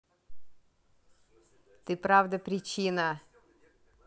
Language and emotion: Russian, neutral